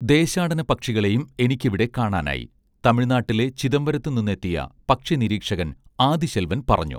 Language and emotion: Malayalam, neutral